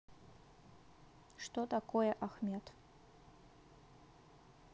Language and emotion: Russian, neutral